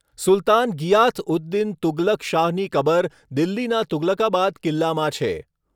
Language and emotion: Gujarati, neutral